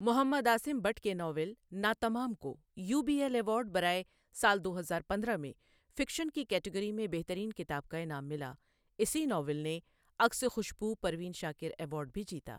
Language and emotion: Urdu, neutral